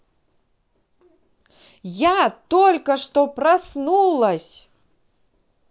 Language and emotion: Russian, positive